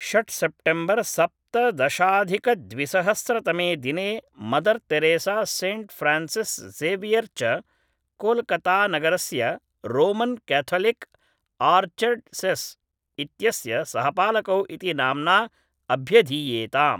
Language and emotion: Sanskrit, neutral